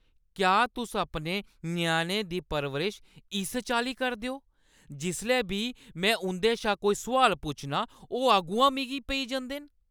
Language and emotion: Dogri, angry